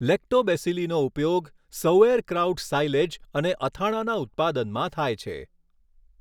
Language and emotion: Gujarati, neutral